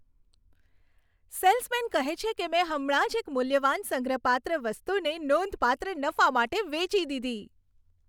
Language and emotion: Gujarati, happy